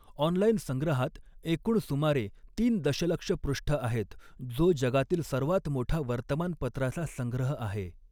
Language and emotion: Marathi, neutral